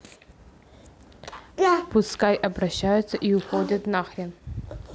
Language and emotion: Russian, neutral